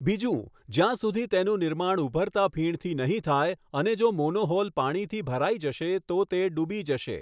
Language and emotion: Gujarati, neutral